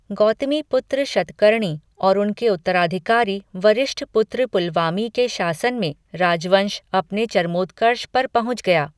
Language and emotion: Hindi, neutral